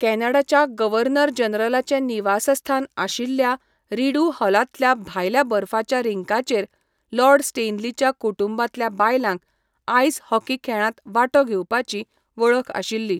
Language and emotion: Goan Konkani, neutral